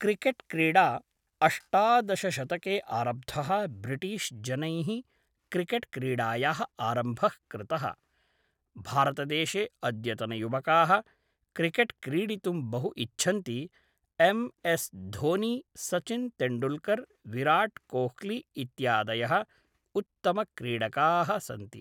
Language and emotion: Sanskrit, neutral